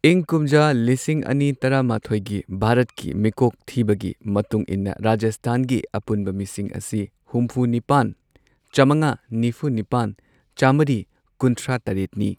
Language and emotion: Manipuri, neutral